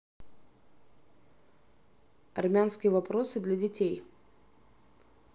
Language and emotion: Russian, neutral